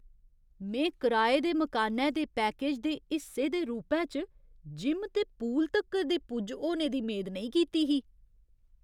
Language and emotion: Dogri, surprised